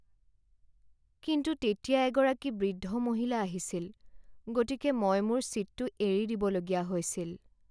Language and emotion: Assamese, sad